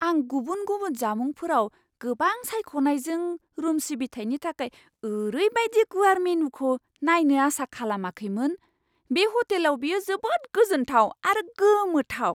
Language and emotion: Bodo, surprised